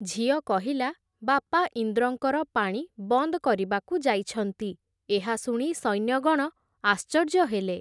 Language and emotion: Odia, neutral